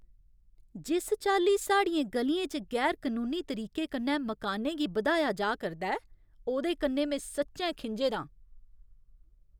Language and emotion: Dogri, angry